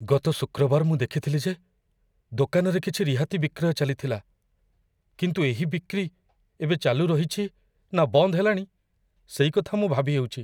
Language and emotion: Odia, fearful